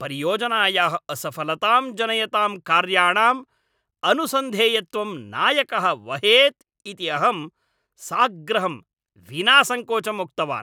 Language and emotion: Sanskrit, angry